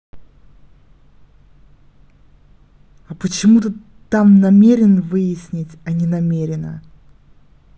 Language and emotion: Russian, angry